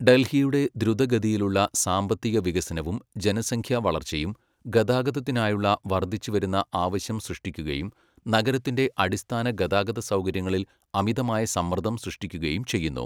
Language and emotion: Malayalam, neutral